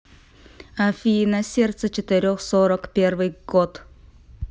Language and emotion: Russian, neutral